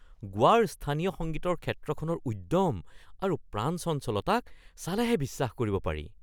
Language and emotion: Assamese, surprised